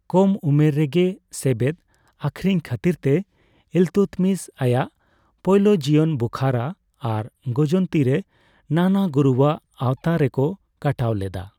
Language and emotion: Santali, neutral